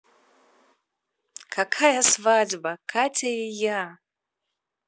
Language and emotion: Russian, positive